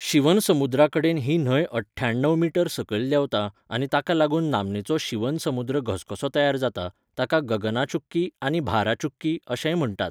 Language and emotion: Goan Konkani, neutral